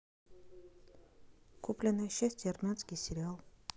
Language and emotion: Russian, neutral